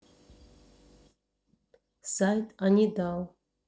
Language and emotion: Russian, neutral